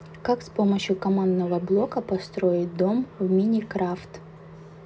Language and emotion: Russian, neutral